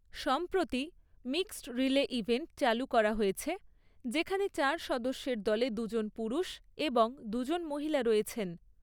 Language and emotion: Bengali, neutral